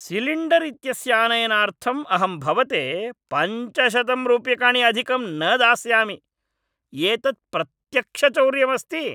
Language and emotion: Sanskrit, angry